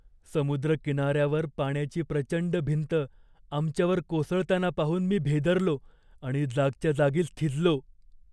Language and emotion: Marathi, fearful